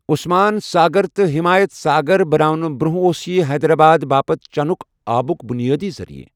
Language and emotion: Kashmiri, neutral